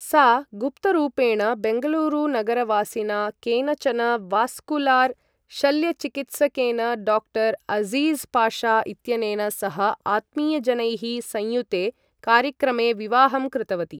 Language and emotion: Sanskrit, neutral